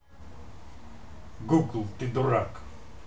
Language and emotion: Russian, angry